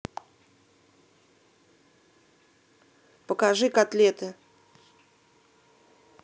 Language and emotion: Russian, angry